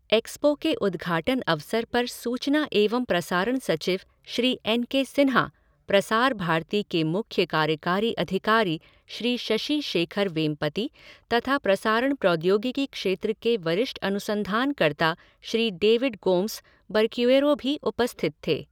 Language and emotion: Hindi, neutral